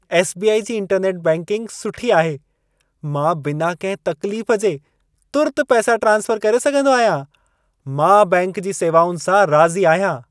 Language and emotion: Sindhi, happy